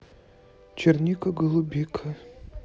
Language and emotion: Russian, neutral